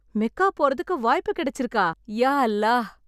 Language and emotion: Tamil, happy